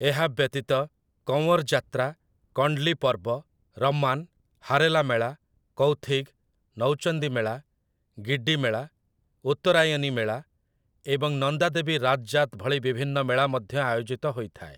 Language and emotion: Odia, neutral